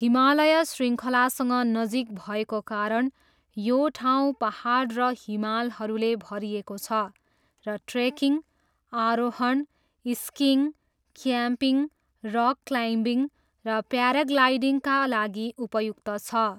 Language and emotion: Nepali, neutral